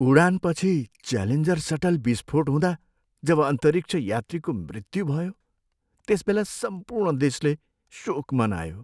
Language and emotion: Nepali, sad